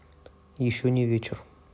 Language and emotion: Russian, neutral